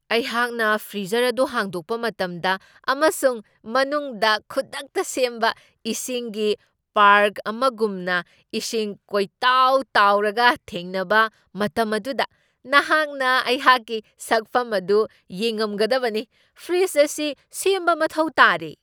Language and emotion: Manipuri, surprised